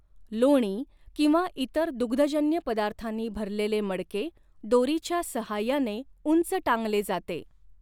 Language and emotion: Marathi, neutral